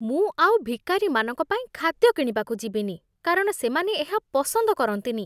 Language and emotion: Odia, disgusted